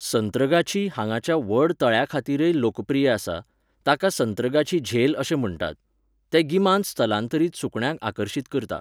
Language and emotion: Goan Konkani, neutral